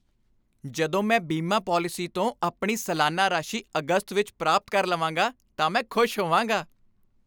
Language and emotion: Punjabi, happy